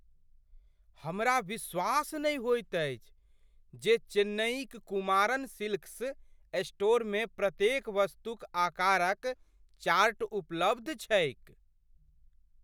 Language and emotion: Maithili, surprised